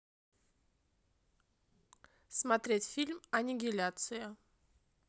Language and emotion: Russian, neutral